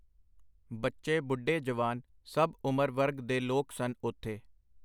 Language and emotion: Punjabi, neutral